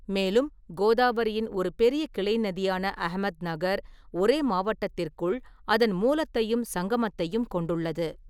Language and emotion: Tamil, neutral